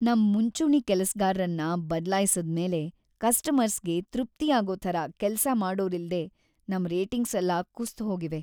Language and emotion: Kannada, sad